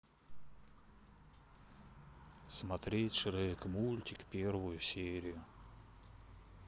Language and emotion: Russian, sad